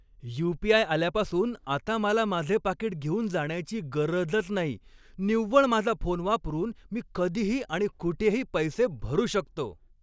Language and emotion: Marathi, happy